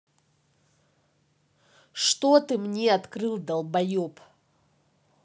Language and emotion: Russian, angry